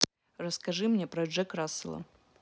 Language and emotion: Russian, neutral